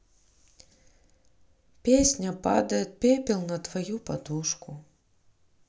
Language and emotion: Russian, sad